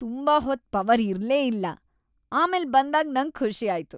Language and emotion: Kannada, happy